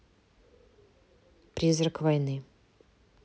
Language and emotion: Russian, neutral